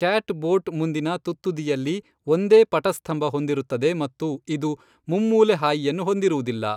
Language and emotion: Kannada, neutral